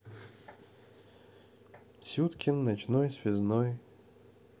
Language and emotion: Russian, neutral